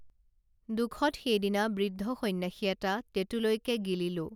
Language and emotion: Assamese, neutral